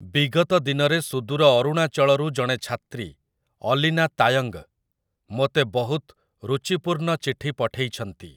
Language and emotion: Odia, neutral